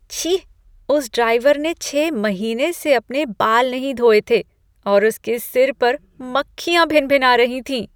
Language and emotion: Hindi, disgusted